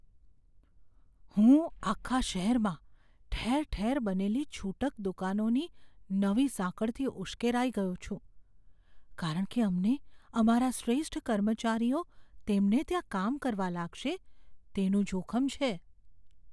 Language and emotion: Gujarati, fearful